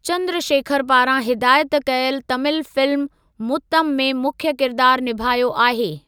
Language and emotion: Sindhi, neutral